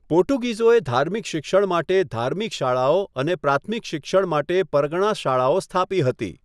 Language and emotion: Gujarati, neutral